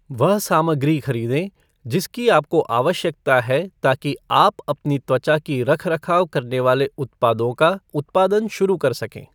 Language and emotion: Hindi, neutral